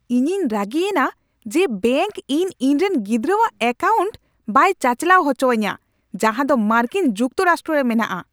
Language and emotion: Santali, angry